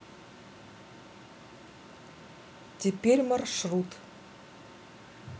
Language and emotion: Russian, neutral